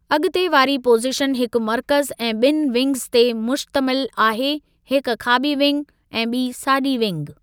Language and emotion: Sindhi, neutral